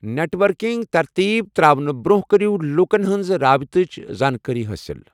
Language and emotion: Kashmiri, neutral